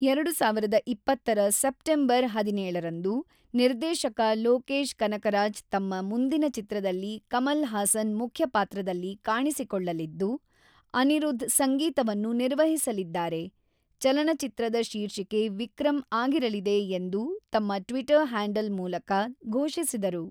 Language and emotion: Kannada, neutral